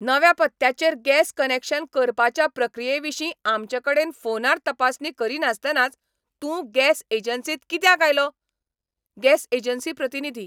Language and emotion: Goan Konkani, angry